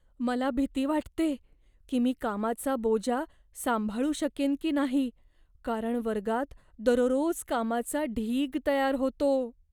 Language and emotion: Marathi, fearful